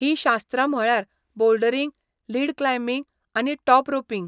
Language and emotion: Goan Konkani, neutral